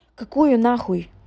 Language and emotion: Russian, angry